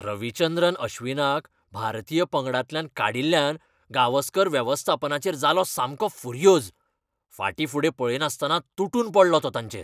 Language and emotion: Goan Konkani, angry